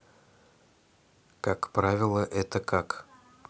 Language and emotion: Russian, neutral